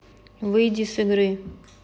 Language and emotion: Russian, neutral